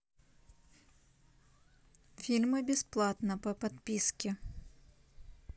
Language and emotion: Russian, neutral